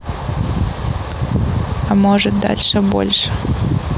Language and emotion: Russian, neutral